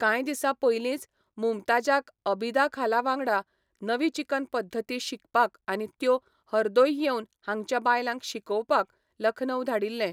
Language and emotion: Goan Konkani, neutral